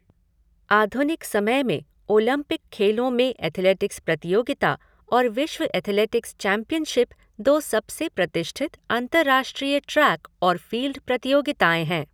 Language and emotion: Hindi, neutral